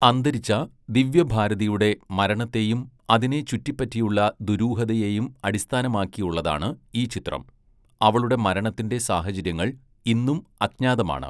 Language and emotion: Malayalam, neutral